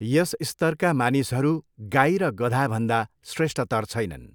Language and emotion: Nepali, neutral